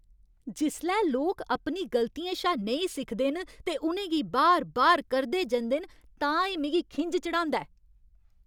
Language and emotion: Dogri, angry